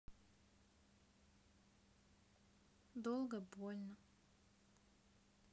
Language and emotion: Russian, sad